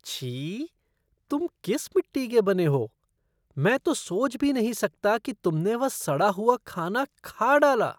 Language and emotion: Hindi, disgusted